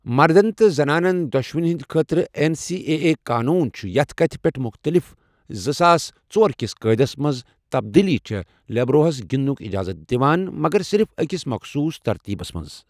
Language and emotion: Kashmiri, neutral